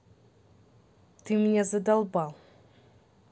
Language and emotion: Russian, angry